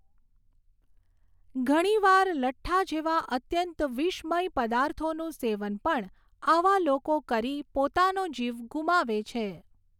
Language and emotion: Gujarati, neutral